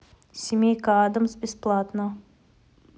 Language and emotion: Russian, neutral